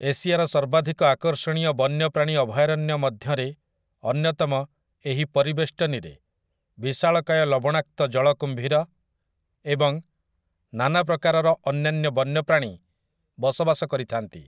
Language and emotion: Odia, neutral